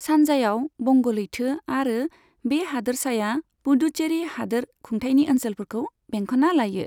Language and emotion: Bodo, neutral